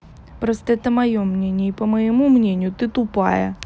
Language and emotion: Russian, angry